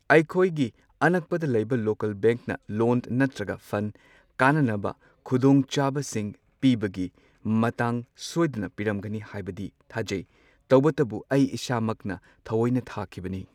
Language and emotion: Manipuri, neutral